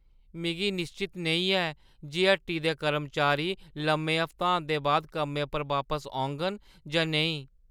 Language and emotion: Dogri, fearful